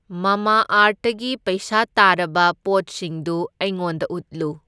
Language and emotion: Manipuri, neutral